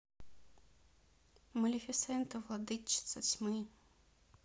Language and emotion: Russian, neutral